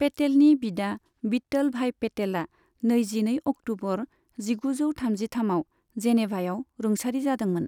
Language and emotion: Bodo, neutral